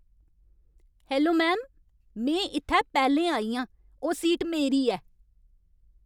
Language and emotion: Dogri, angry